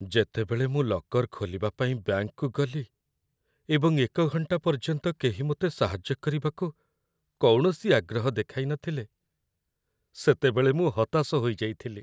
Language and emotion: Odia, sad